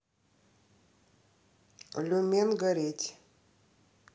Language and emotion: Russian, neutral